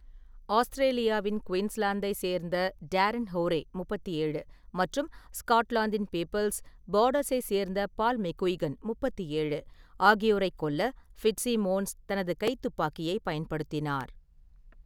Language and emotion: Tamil, neutral